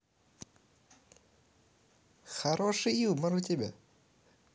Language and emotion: Russian, positive